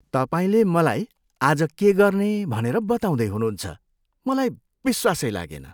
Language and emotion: Nepali, disgusted